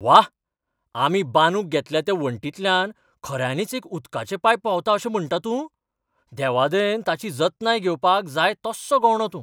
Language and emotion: Goan Konkani, surprised